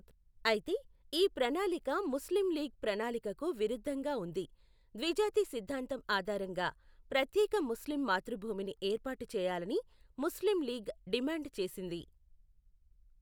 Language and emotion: Telugu, neutral